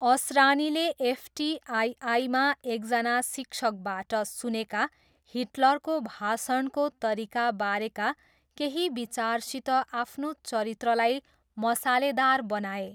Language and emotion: Nepali, neutral